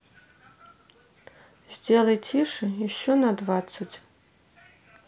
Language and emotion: Russian, sad